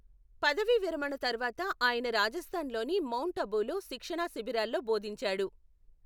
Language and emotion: Telugu, neutral